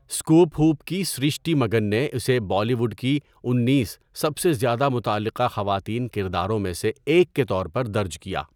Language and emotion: Urdu, neutral